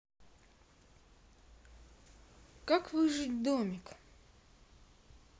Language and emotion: Russian, neutral